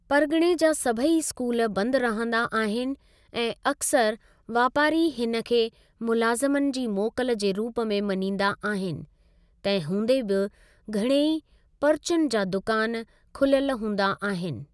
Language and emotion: Sindhi, neutral